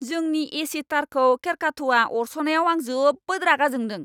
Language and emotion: Bodo, angry